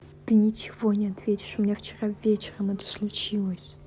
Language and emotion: Russian, angry